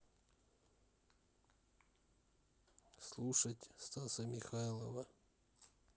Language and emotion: Russian, neutral